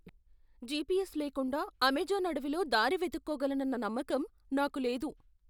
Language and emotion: Telugu, fearful